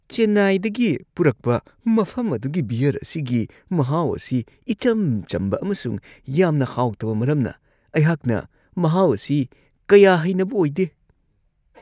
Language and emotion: Manipuri, disgusted